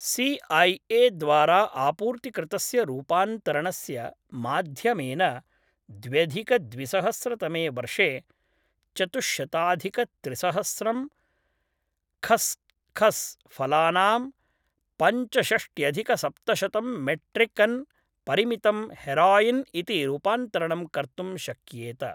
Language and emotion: Sanskrit, neutral